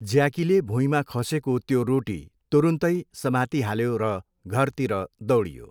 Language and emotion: Nepali, neutral